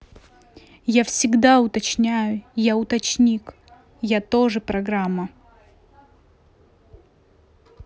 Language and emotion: Russian, angry